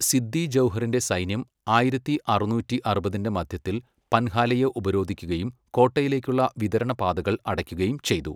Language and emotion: Malayalam, neutral